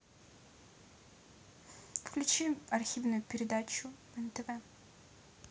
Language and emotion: Russian, neutral